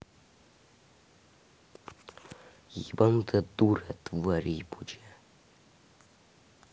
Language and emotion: Russian, angry